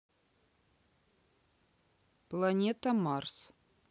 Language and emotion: Russian, neutral